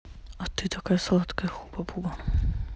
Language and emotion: Russian, neutral